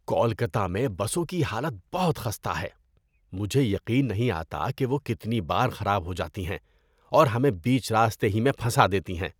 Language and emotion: Urdu, disgusted